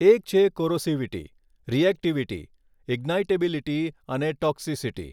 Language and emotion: Gujarati, neutral